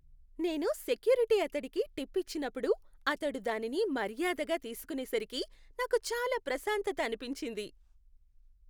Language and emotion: Telugu, happy